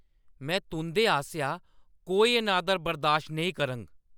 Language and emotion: Dogri, angry